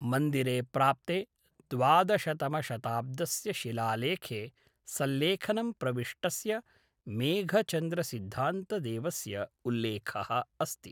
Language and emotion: Sanskrit, neutral